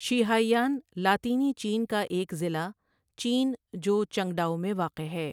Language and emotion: Urdu, neutral